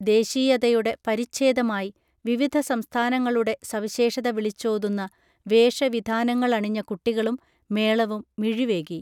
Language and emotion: Malayalam, neutral